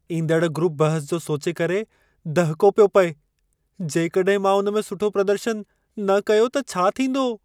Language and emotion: Sindhi, fearful